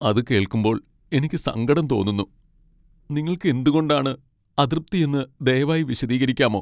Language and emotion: Malayalam, sad